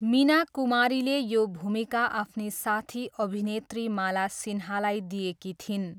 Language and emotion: Nepali, neutral